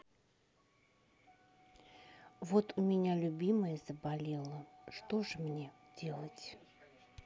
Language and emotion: Russian, sad